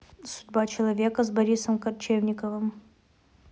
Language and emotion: Russian, neutral